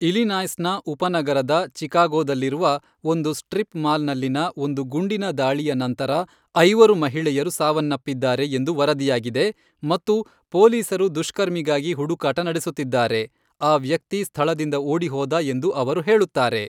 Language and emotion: Kannada, neutral